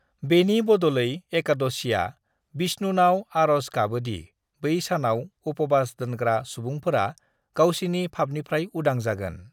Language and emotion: Bodo, neutral